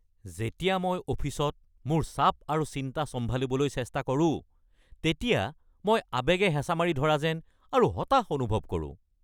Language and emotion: Assamese, angry